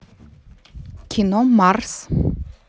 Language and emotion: Russian, neutral